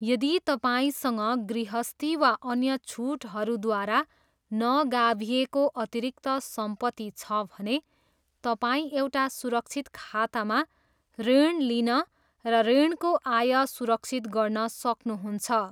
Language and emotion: Nepali, neutral